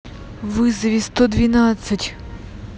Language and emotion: Russian, angry